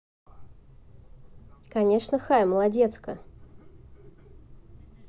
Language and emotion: Russian, positive